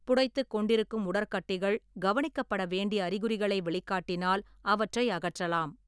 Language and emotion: Tamil, neutral